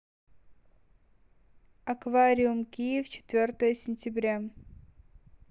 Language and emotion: Russian, neutral